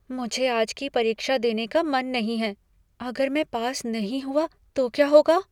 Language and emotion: Hindi, fearful